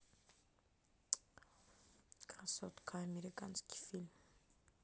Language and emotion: Russian, neutral